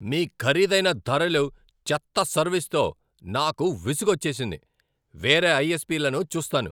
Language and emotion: Telugu, angry